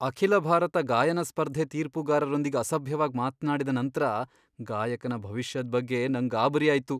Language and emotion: Kannada, fearful